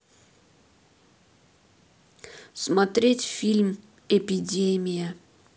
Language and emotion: Russian, neutral